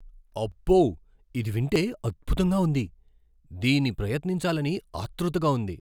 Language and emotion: Telugu, surprised